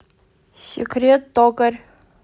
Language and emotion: Russian, neutral